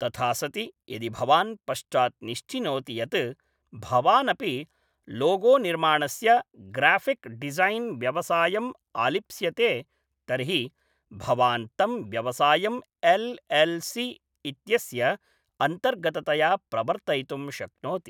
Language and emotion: Sanskrit, neutral